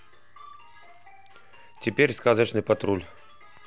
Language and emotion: Russian, neutral